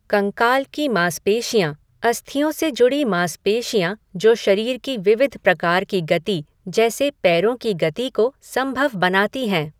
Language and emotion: Hindi, neutral